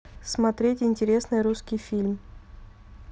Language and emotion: Russian, neutral